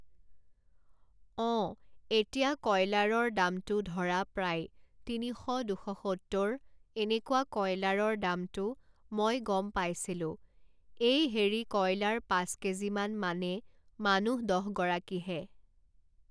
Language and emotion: Assamese, neutral